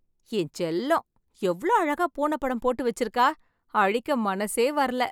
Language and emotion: Tamil, happy